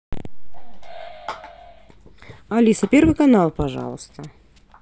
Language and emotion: Russian, neutral